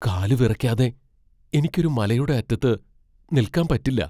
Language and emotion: Malayalam, fearful